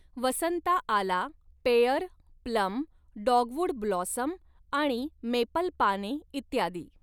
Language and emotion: Marathi, neutral